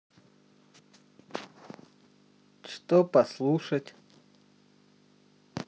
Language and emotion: Russian, neutral